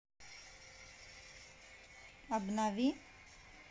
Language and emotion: Russian, neutral